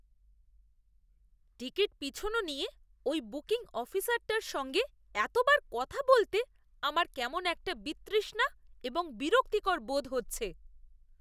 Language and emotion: Bengali, disgusted